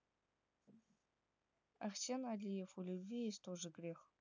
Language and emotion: Russian, neutral